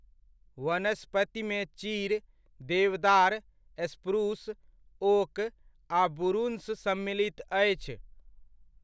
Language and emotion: Maithili, neutral